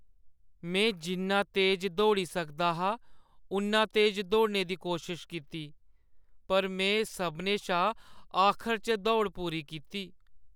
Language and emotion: Dogri, sad